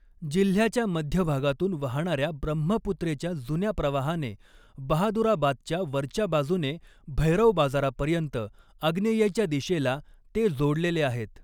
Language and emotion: Marathi, neutral